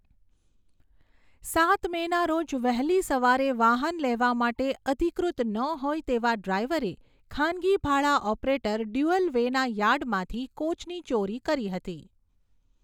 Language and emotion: Gujarati, neutral